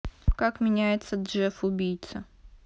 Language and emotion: Russian, neutral